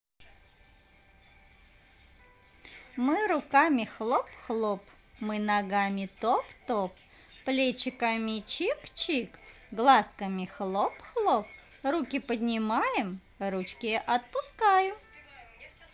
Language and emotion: Russian, positive